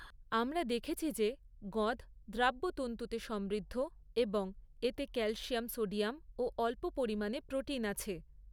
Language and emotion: Bengali, neutral